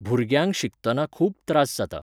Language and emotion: Goan Konkani, neutral